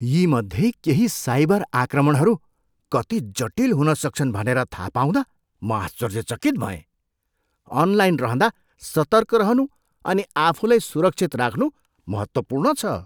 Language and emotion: Nepali, surprised